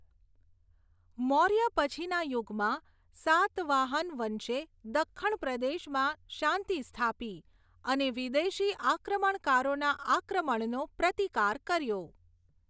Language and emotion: Gujarati, neutral